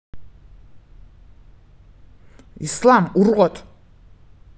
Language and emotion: Russian, angry